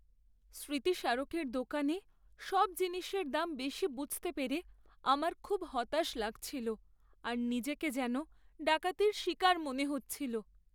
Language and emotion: Bengali, sad